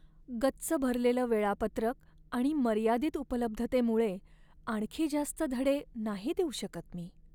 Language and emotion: Marathi, sad